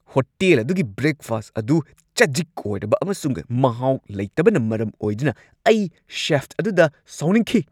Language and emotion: Manipuri, angry